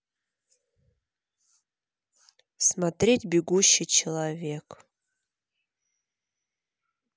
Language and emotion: Russian, neutral